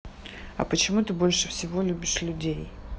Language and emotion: Russian, neutral